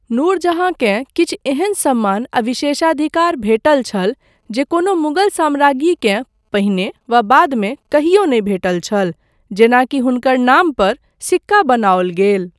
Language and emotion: Maithili, neutral